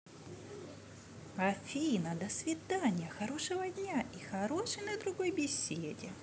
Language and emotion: Russian, positive